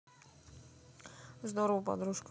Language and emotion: Russian, neutral